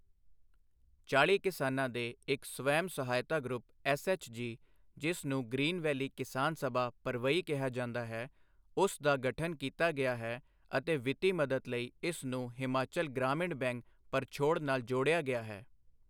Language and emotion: Punjabi, neutral